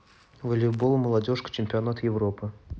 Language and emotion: Russian, neutral